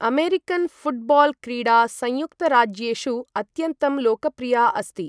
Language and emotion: Sanskrit, neutral